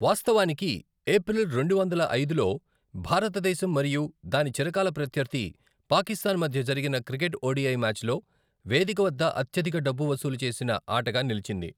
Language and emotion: Telugu, neutral